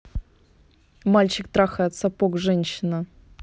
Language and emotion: Russian, neutral